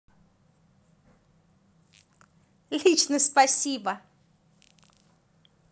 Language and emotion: Russian, positive